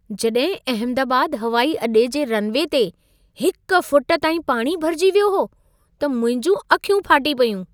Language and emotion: Sindhi, surprised